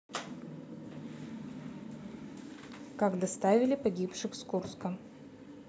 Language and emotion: Russian, neutral